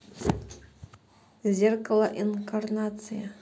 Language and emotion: Russian, neutral